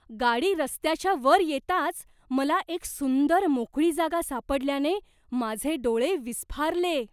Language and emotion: Marathi, surprised